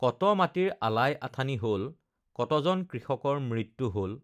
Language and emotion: Assamese, neutral